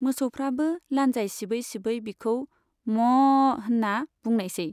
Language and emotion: Bodo, neutral